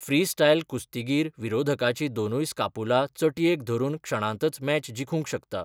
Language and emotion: Goan Konkani, neutral